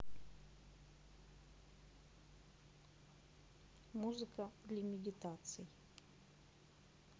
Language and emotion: Russian, neutral